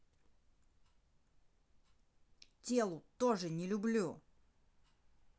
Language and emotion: Russian, angry